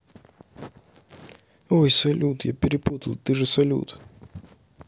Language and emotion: Russian, neutral